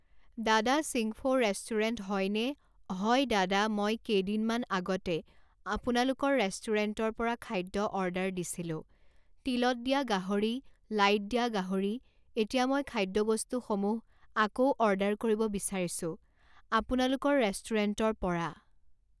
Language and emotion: Assamese, neutral